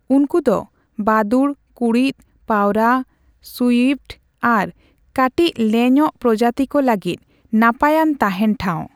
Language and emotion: Santali, neutral